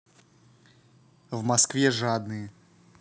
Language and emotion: Russian, neutral